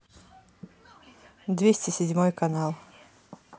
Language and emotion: Russian, neutral